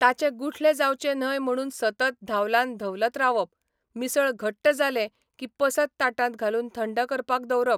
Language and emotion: Goan Konkani, neutral